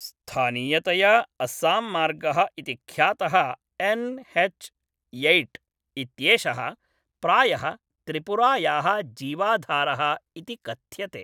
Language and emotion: Sanskrit, neutral